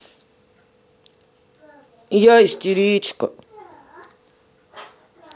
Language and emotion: Russian, sad